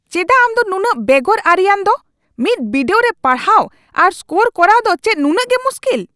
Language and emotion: Santali, angry